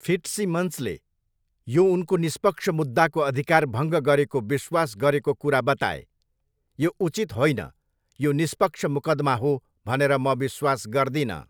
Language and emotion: Nepali, neutral